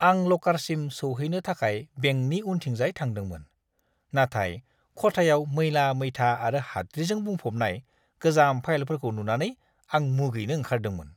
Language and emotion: Bodo, disgusted